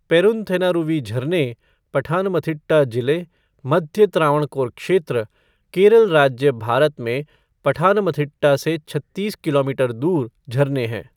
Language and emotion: Hindi, neutral